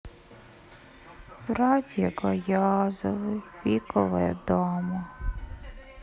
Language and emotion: Russian, sad